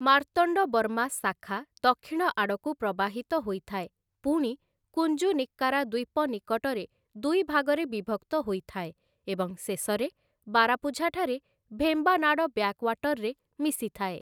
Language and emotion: Odia, neutral